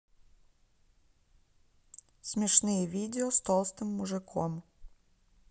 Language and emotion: Russian, neutral